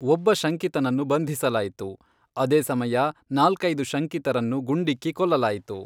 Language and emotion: Kannada, neutral